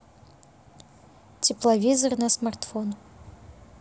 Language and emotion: Russian, neutral